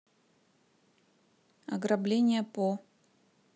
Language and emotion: Russian, neutral